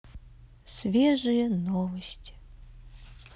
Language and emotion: Russian, sad